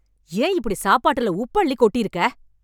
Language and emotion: Tamil, angry